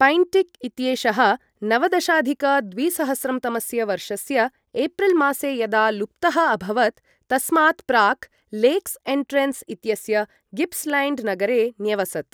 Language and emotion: Sanskrit, neutral